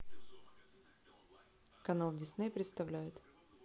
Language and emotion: Russian, neutral